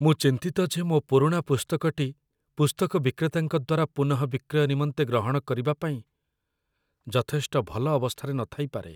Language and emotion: Odia, fearful